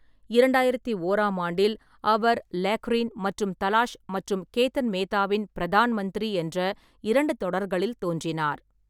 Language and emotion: Tamil, neutral